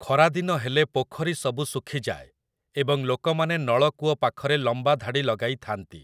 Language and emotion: Odia, neutral